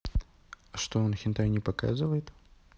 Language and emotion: Russian, neutral